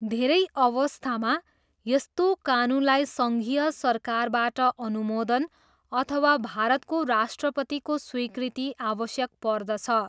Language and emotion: Nepali, neutral